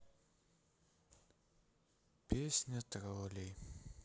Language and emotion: Russian, sad